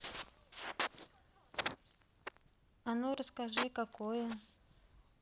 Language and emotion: Russian, neutral